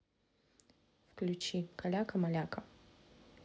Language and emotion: Russian, neutral